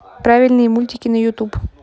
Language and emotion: Russian, neutral